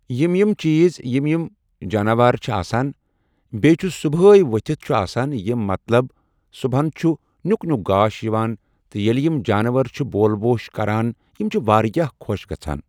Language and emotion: Kashmiri, neutral